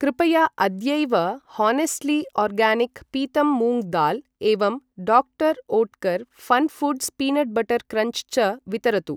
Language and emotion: Sanskrit, neutral